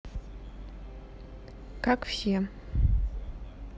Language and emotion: Russian, neutral